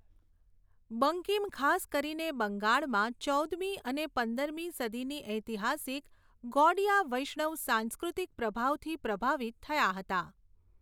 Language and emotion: Gujarati, neutral